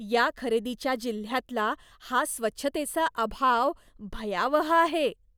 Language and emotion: Marathi, disgusted